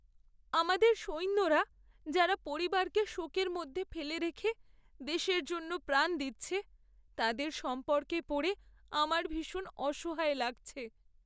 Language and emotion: Bengali, sad